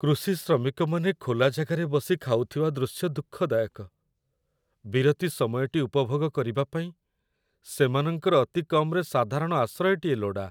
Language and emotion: Odia, sad